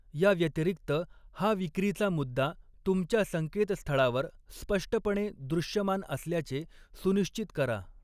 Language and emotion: Marathi, neutral